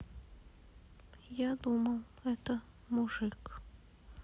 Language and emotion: Russian, sad